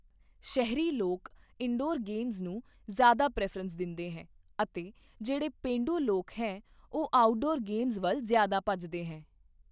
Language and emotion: Punjabi, neutral